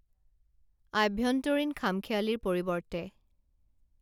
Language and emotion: Assamese, neutral